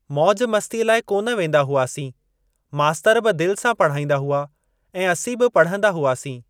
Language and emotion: Sindhi, neutral